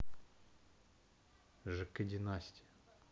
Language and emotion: Russian, neutral